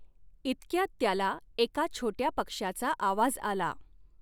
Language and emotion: Marathi, neutral